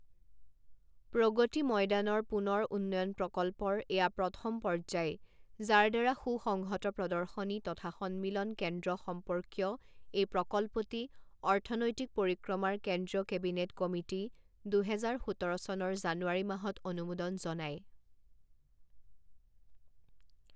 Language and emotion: Assamese, neutral